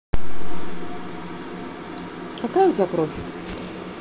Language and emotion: Russian, neutral